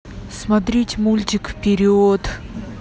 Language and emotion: Russian, neutral